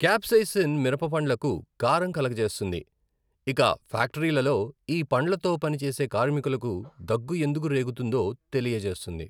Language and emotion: Telugu, neutral